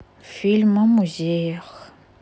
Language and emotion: Russian, sad